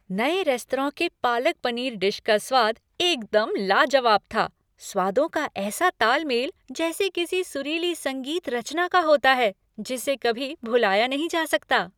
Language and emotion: Hindi, happy